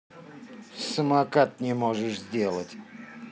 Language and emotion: Russian, angry